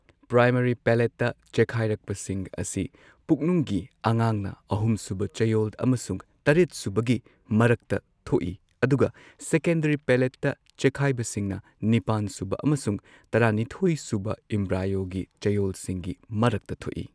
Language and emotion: Manipuri, neutral